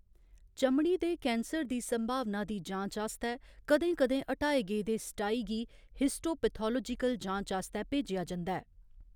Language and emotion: Dogri, neutral